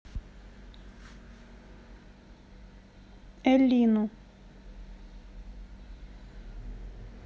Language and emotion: Russian, neutral